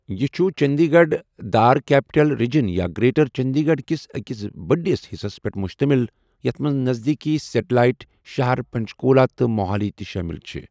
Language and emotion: Kashmiri, neutral